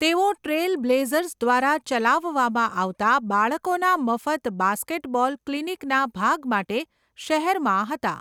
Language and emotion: Gujarati, neutral